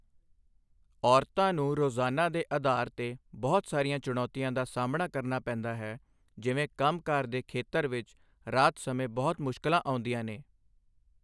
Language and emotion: Punjabi, neutral